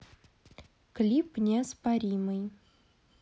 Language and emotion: Russian, neutral